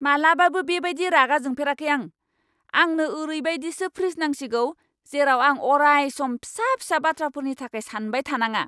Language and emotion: Bodo, angry